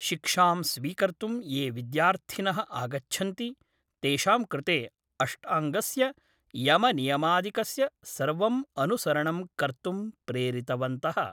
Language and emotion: Sanskrit, neutral